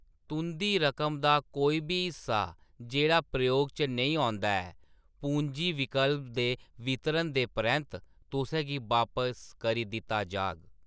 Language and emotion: Dogri, neutral